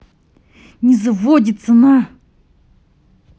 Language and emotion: Russian, angry